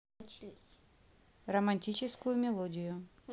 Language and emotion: Russian, neutral